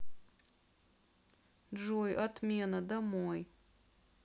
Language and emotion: Russian, sad